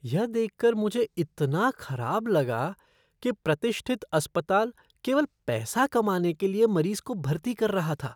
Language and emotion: Hindi, disgusted